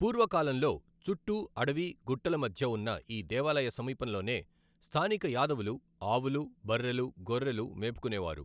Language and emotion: Telugu, neutral